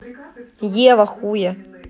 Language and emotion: Russian, angry